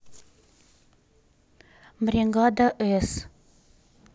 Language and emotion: Russian, neutral